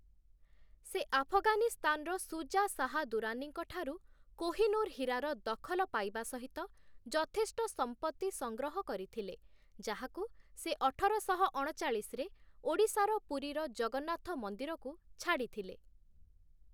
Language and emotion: Odia, neutral